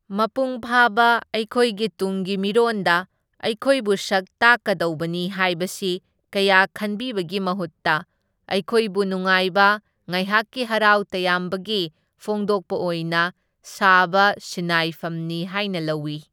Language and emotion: Manipuri, neutral